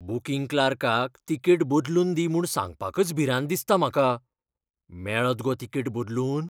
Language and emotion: Goan Konkani, fearful